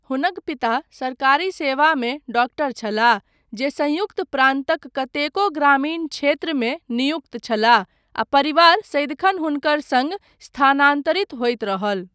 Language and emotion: Maithili, neutral